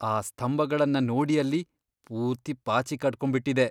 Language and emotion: Kannada, disgusted